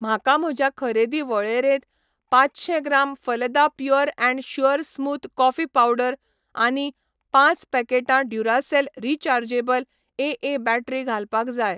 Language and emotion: Goan Konkani, neutral